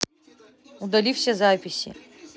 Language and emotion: Russian, neutral